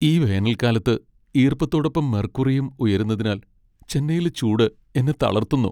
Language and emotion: Malayalam, sad